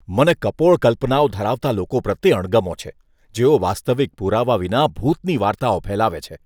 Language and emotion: Gujarati, disgusted